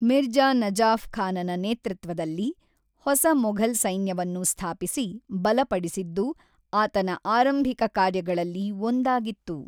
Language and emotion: Kannada, neutral